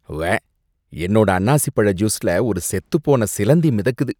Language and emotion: Tamil, disgusted